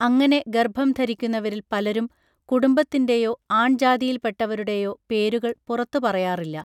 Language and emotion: Malayalam, neutral